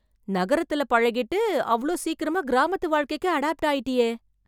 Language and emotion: Tamil, surprised